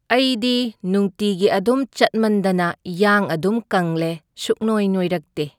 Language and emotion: Manipuri, neutral